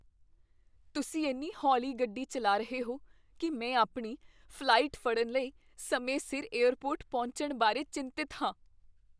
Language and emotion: Punjabi, fearful